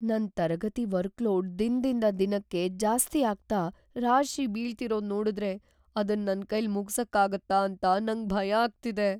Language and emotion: Kannada, fearful